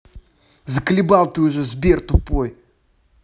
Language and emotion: Russian, angry